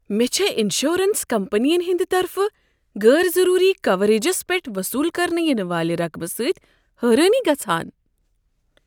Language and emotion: Kashmiri, surprised